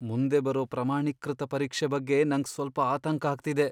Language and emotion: Kannada, fearful